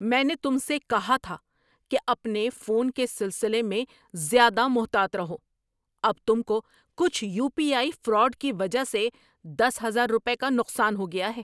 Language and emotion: Urdu, angry